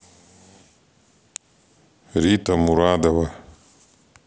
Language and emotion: Russian, neutral